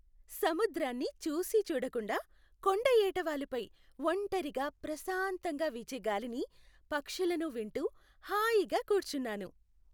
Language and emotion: Telugu, happy